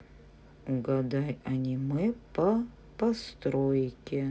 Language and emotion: Russian, neutral